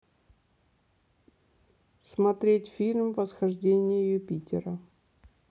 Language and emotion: Russian, neutral